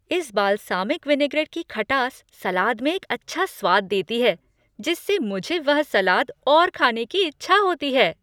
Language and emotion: Hindi, happy